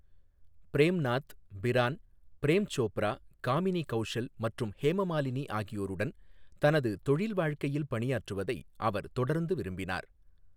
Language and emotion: Tamil, neutral